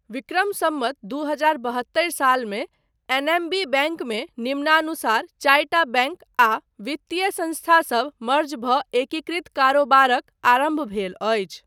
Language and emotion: Maithili, neutral